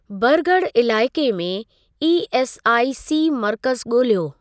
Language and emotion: Sindhi, neutral